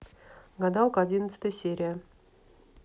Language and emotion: Russian, neutral